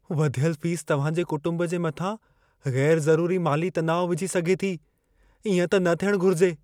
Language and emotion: Sindhi, fearful